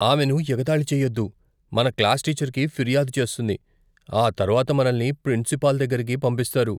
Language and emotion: Telugu, fearful